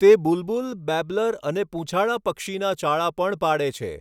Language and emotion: Gujarati, neutral